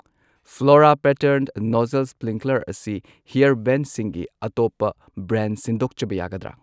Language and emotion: Manipuri, neutral